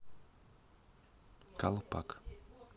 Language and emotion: Russian, neutral